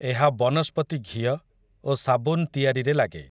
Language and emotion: Odia, neutral